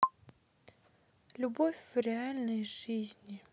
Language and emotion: Russian, neutral